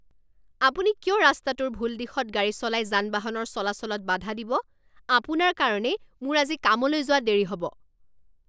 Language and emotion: Assamese, angry